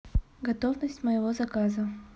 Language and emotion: Russian, neutral